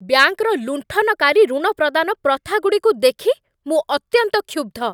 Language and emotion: Odia, angry